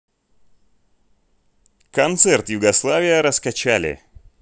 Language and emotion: Russian, neutral